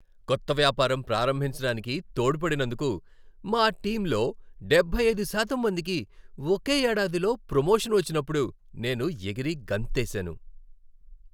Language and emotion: Telugu, happy